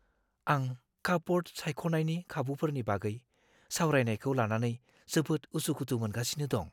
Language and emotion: Bodo, fearful